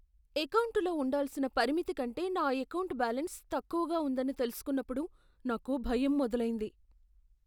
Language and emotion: Telugu, fearful